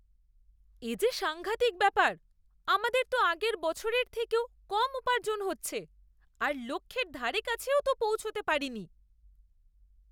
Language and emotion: Bengali, disgusted